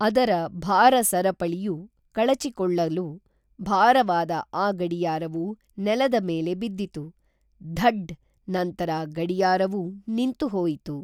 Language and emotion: Kannada, neutral